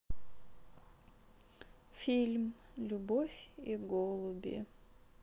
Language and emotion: Russian, sad